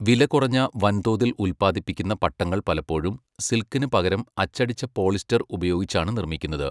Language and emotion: Malayalam, neutral